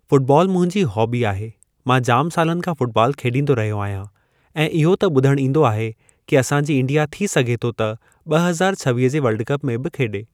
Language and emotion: Sindhi, neutral